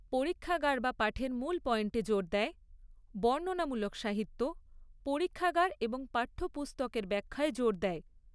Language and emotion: Bengali, neutral